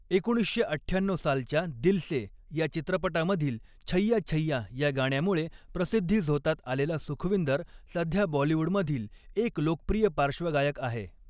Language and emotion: Marathi, neutral